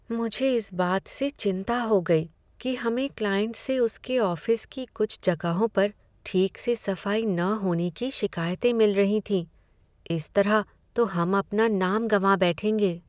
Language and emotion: Hindi, sad